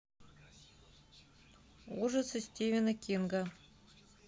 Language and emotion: Russian, neutral